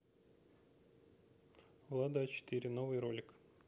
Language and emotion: Russian, neutral